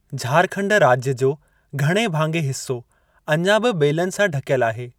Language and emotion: Sindhi, neutral